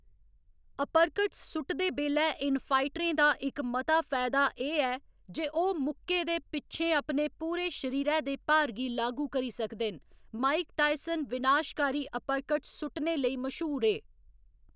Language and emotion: Dogri, neutral